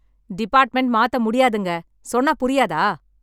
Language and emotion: Tamil, angry